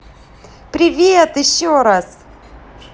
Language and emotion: Russian, positive